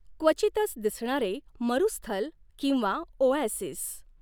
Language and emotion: Marathi, neutral